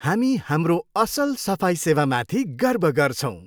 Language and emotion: Nepali, happy